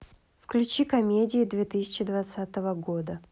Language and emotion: Russian, neutral